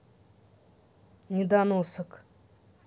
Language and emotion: Russian, angry